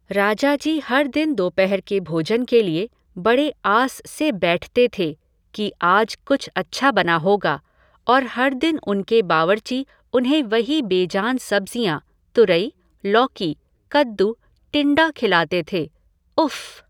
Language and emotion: Hindi, neutral